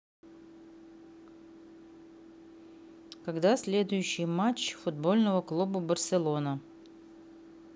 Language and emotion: Russian, neutral